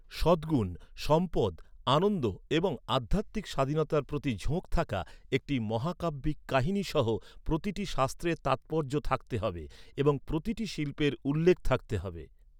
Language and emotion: Bengali, neutral